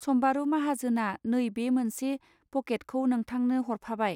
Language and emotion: Bodo, neutral